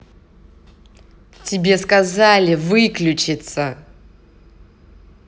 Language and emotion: Russian, angry